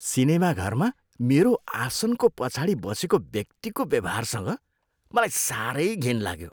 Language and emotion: Nepali, disgusted